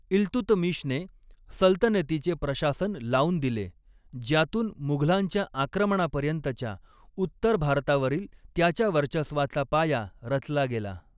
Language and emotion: Marathi, neutral